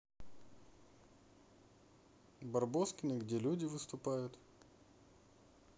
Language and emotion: Russian, neutral